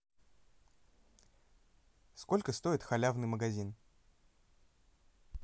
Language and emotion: Russian, neutral